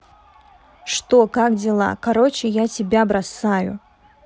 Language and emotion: Russian, neutral